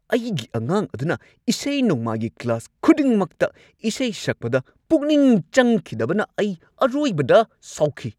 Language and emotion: Manipuri, angry